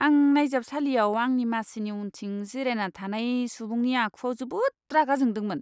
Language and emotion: Bodo, disgusted